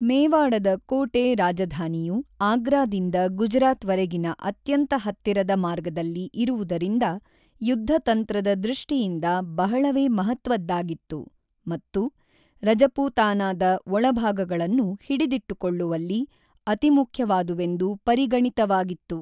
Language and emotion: Kannada, neutral